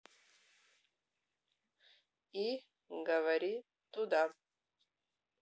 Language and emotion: Russian, neutral